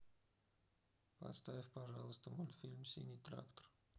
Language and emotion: Russian, sad